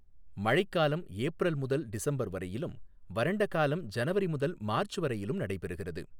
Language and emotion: Tamil, neutral